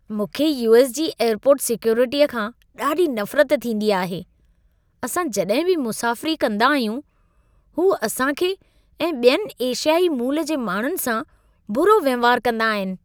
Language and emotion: Sindhi, disgusted